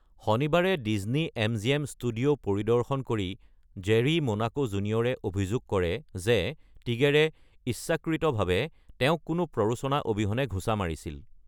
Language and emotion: Assamese, neutral